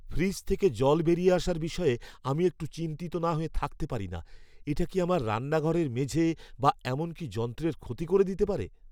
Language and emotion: Bengali, fearful